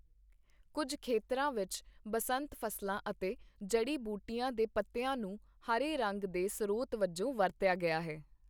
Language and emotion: Punjabi, neutral